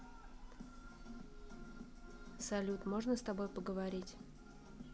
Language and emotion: Russian, neutral